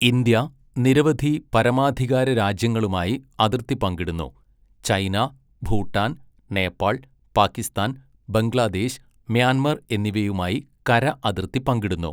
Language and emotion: Malayalam, neutral